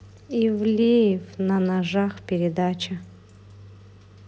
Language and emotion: Russian, neutral